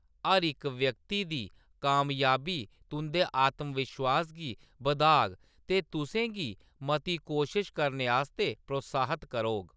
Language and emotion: Dogri, neutral